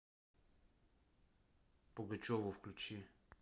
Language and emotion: Russian, neutral